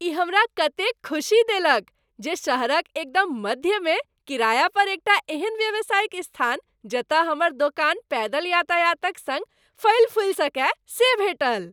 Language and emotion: Maithili, happy